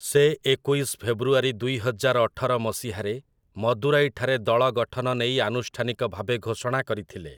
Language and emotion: Odia, neutral